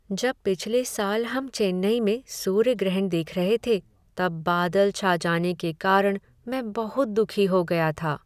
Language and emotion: Hindi, sad